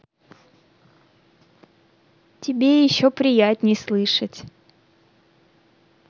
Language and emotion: Russian, neutral